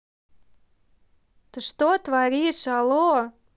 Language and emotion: Russian, angry